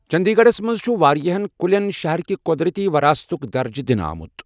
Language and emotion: Kashmiri, neutral